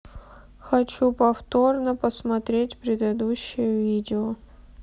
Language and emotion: Russian, sad